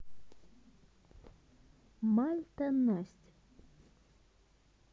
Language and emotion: Russian, neutral